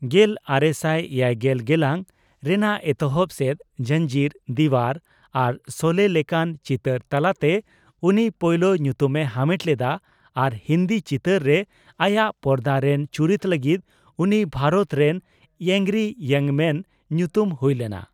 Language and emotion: Santali, neutral